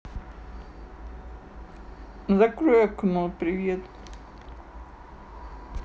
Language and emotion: Russian, neutral